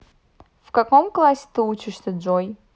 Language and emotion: Russian, neutral